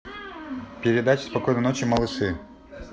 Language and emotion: Russian, neutral